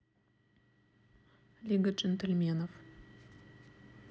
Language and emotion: Russian, neutral